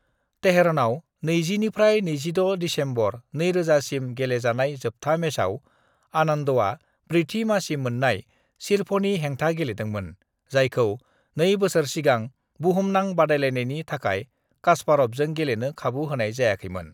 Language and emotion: Bodo, neutral